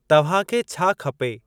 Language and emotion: Sindhi, neutral